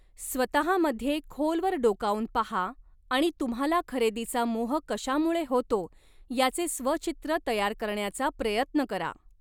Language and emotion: Marathi, neutral